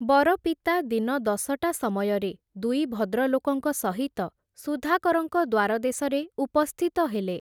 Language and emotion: Odia, neutral